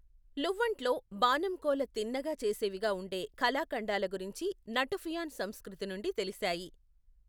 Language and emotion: Telugu, neutral